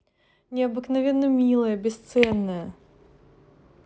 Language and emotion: Russian, positive